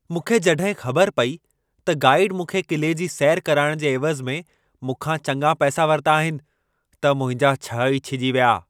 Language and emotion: Sindhi, angry